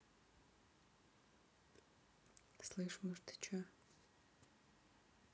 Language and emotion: Russian, neutral